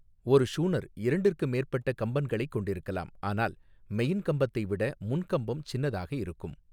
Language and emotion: Tamil, neutral